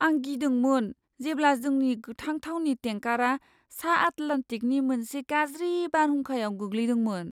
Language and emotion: Bodo, fearful